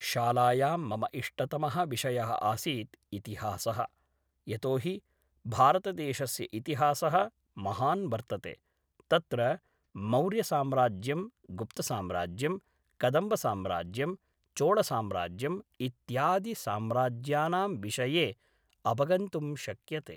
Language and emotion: Sanskrit, neutral